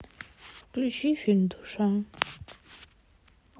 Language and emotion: Russian, sad